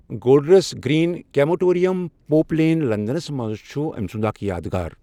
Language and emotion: Kashmiri, neutral